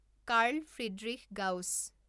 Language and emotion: Assamese, neutral